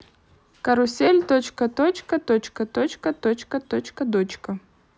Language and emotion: Russian, neutral